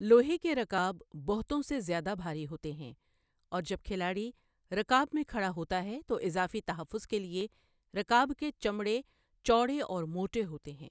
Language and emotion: Urdu, neutral